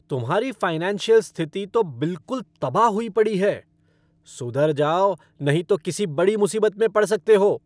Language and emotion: Hindi, angry